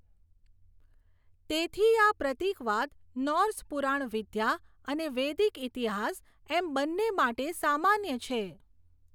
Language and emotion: Gujarati, neutral